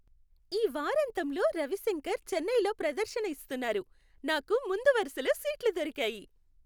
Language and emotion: Telugu, happy